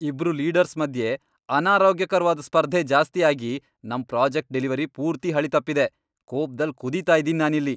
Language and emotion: Kannada, angry